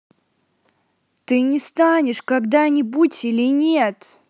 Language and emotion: Russian, angry